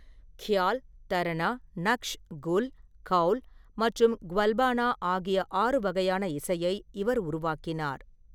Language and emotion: Tamil, neutral